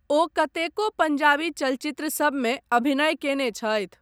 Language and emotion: Maithili, neutral